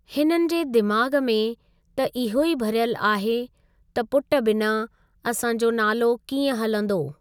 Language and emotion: Sindhi, neutral